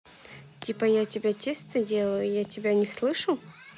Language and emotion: Russian, neutral